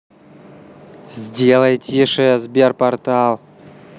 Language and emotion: Russian, angry